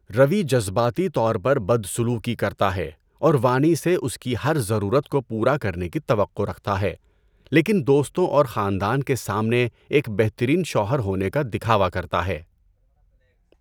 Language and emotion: Urdu, neutral